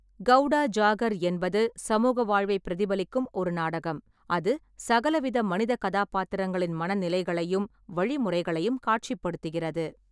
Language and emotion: Tamil, neutral